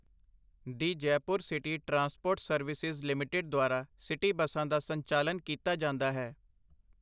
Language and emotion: Punjabi, neutral